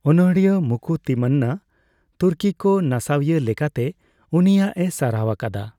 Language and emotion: Santali, neutral